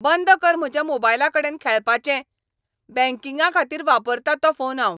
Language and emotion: Goan Konkani, angry